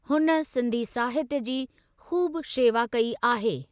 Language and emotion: Sindhi, neutral